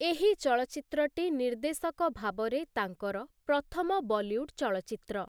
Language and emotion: Odia, neutral